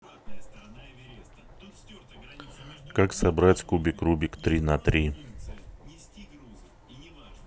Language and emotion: Russian, neutral